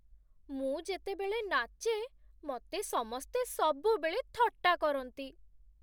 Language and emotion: Odia, sad